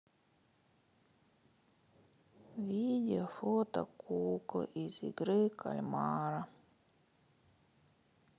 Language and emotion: Russian, sad